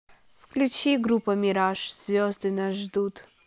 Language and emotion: Russian, neutral